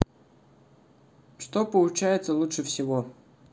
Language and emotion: Russian, neutral